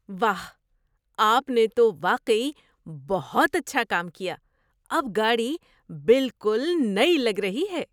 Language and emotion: Urdu, surprised